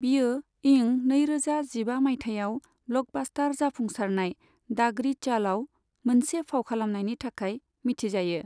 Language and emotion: Bodo, neutral